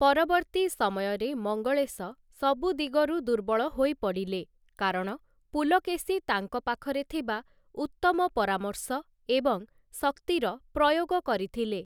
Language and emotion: Odia, neutral